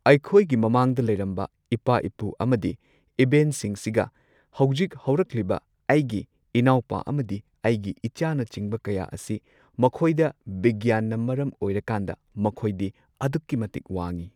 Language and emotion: Manipuri, neutral